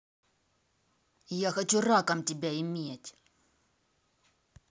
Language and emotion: Russian, angry